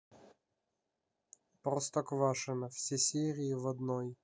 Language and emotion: Russian, neutral